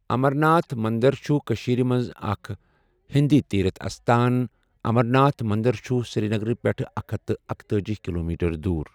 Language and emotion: Kashmiri, neutral